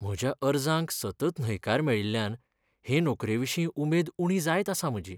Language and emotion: Goan Konkani, sad